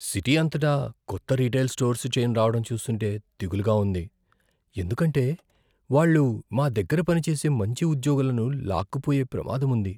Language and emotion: Telugu, fearful